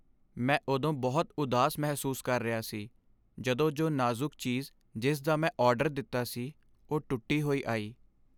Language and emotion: Punjabi, sad